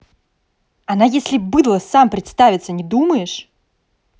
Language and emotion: Russian, angry